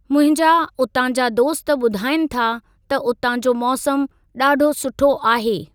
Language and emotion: Sindhi, neutral